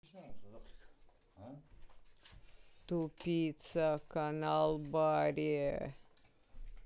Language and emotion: Russian, angry